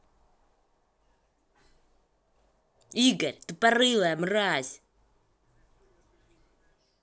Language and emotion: Russian, angry